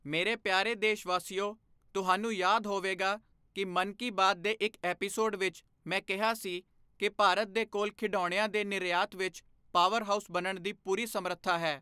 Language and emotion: Punjabi, neutral